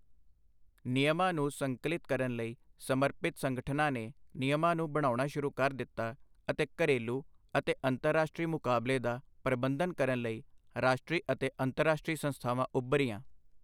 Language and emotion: Punjabi, neutral